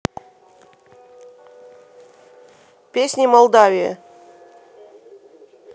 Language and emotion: Russian, neutral